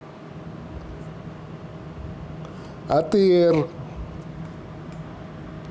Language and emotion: Russian, neutral